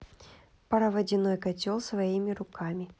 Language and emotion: Russian, neutral